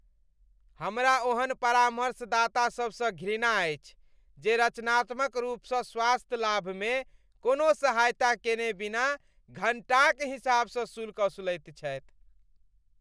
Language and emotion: Maithili, disgusted